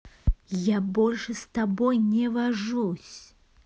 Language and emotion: Russian, angry